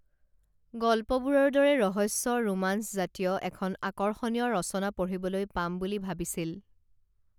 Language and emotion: Assamese, neutral